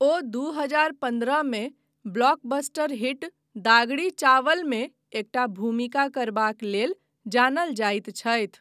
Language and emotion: Maithili, neutral